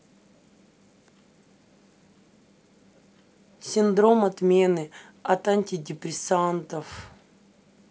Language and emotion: Russian, neutral